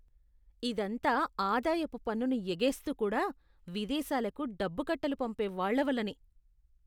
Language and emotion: Telugu, disgusted